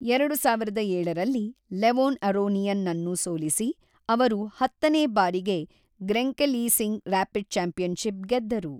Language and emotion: Kannada, neutral